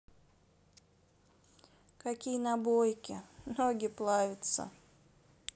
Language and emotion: Russian, sad